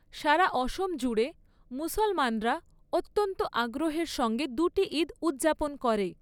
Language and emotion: Bengali, neutral